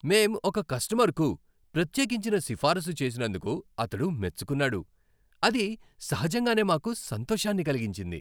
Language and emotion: Telugu, happy